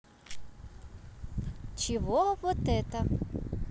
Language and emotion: Russian, positive